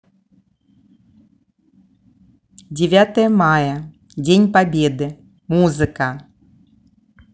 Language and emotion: Russian, neutral